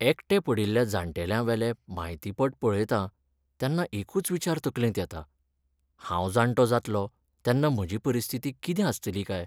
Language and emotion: Goan Konkani, sad